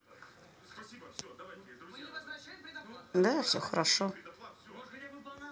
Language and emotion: Russian, neutral